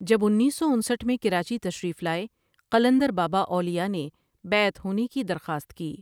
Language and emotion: Urdu, neutral